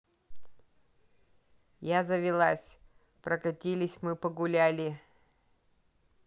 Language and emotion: Russian, neutral